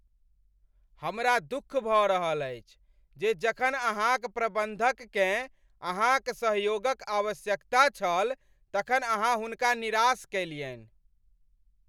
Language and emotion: Maithili, angry